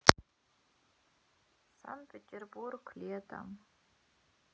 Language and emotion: Russian, sad